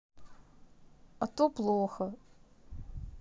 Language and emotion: Russian, sad